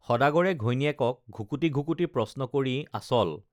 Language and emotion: Assamese, neutral